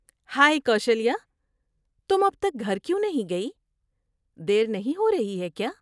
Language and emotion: Urdu, surprised